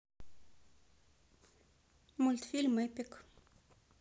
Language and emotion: Russian, neutral